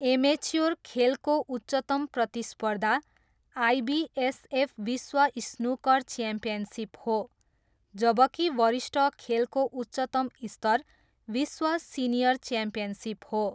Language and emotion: Nepali, neutral